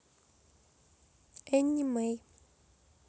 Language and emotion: Russian, neutral